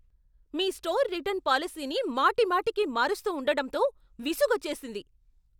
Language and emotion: Telugu, angry